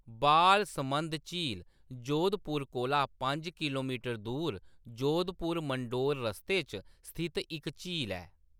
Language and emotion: Dogri, neutral